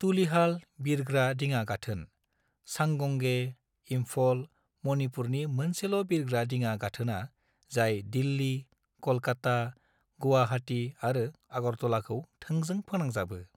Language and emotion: Bodo, neutral